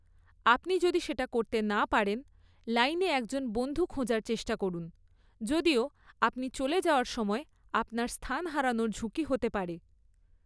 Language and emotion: Bengali, neutral